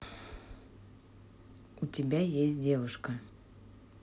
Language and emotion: Russian, neutral